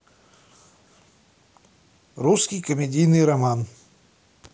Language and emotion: Russian, neutral